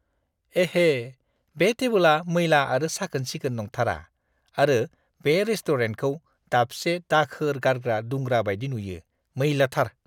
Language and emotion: Bodo, disgusted